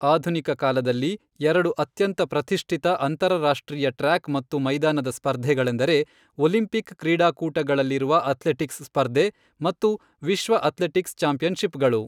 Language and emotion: Kannada, neutral